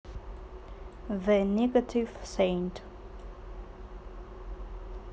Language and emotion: Russian, neutral